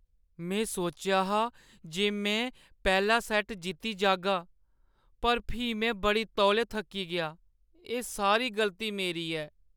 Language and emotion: Dogri, sad